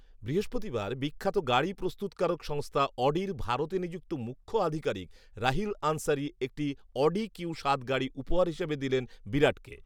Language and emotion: Bengali, neutral